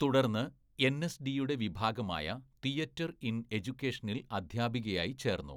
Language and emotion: Malayalam, neutral